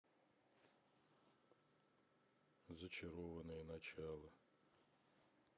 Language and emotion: Russian, neutral